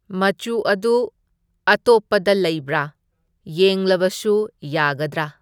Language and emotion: Manipuri, neutral